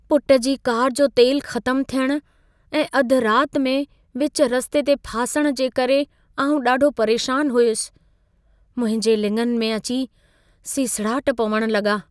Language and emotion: Sindhi, fearful